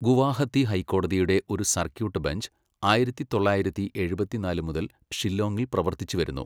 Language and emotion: Malayalam, neutral